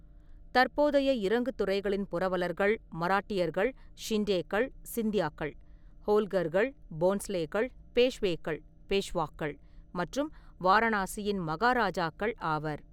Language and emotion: Tamil, neutral